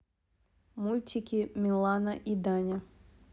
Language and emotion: Russian, neutral